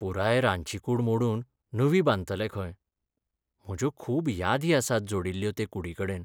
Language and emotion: Goan Konkani, sad